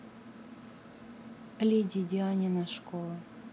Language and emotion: Russian, neutral